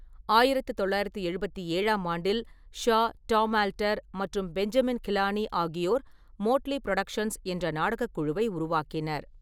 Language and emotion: Tamil, neutral